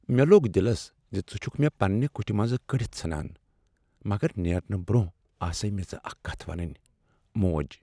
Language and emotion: Kashmiri, sad